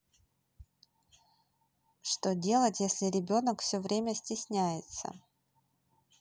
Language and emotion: Russian, neutral